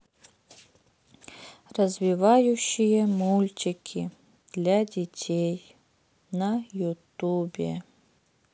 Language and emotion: Russian, sad